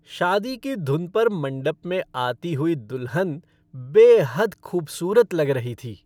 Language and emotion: Hindi, happy